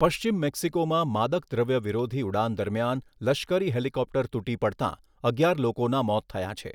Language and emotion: Gujarati, neutral